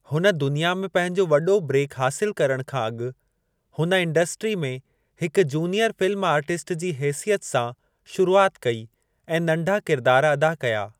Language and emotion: Sindhi, neutral